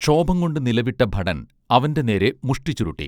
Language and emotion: Malayalam, neutral